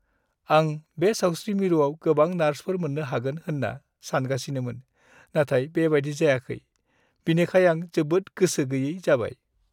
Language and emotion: Bodo, sad